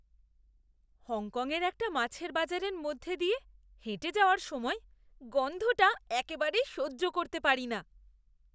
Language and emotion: Bengali, disgusted